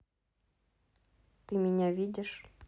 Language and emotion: Russian, neutral